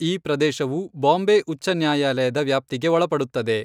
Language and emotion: Kannada, neutral